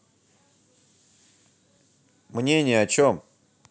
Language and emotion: Russian, angry